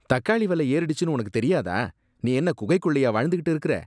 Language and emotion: Tamil, disgusted